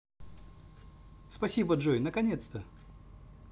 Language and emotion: Russian, positive